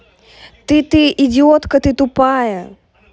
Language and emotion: Russian, angry